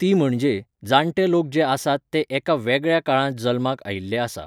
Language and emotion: Goan Konkani, neutral